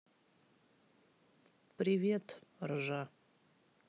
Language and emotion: Russian, sad